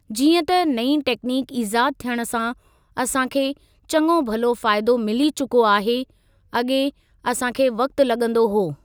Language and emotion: Sindhi, neutral